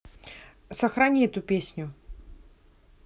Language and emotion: Russian, neutral